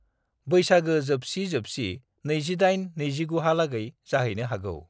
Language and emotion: Bodo, neutral